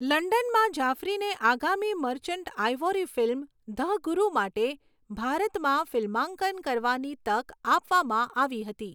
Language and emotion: Gujarati, neutral